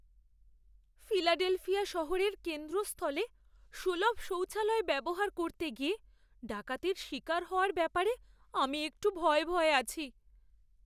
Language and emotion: Bengali, fearful